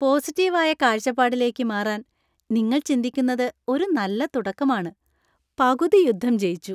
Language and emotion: Malayalam, happy